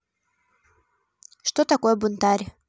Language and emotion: Russian, neutral